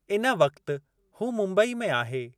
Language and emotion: Sindhi, neutral